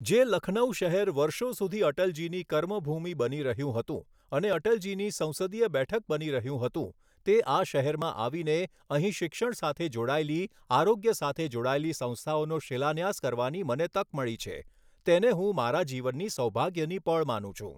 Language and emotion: Gujarati, neutral